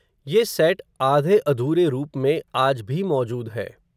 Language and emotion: Hindi, neutral